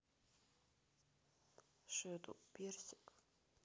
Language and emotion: Russian, neutral